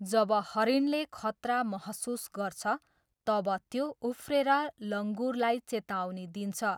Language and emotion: Nepali, neutral